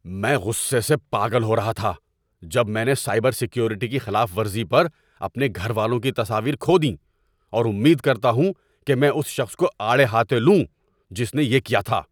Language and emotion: Urdu, angry